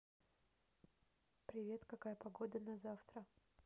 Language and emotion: Russian, neutral